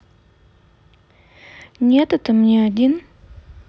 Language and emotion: Russian, neutral